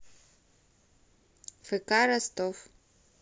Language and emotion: Russian, neutral